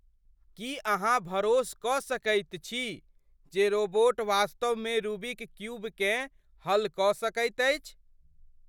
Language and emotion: Maithili, surprised